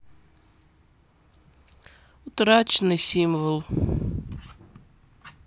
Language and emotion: Russian, sad